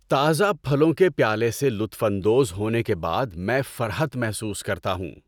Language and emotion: Urdu, happy